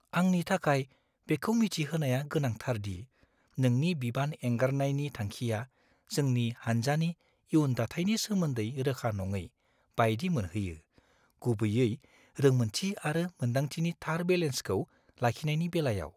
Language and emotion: Bodo, fearful